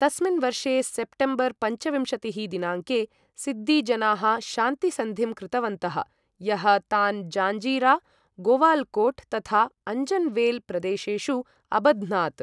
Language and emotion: Sanskrit, neutral